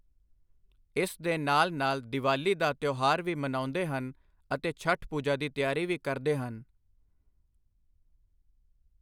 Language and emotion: Punjabi, neutral